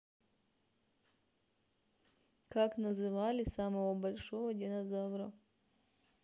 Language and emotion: Russian, neutral